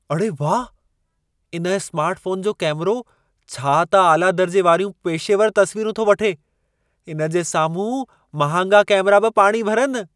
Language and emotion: Sindhi, surprised